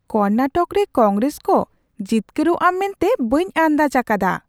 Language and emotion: Santali, surprised